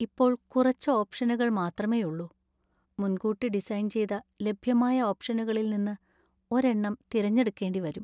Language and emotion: Malayalam, sad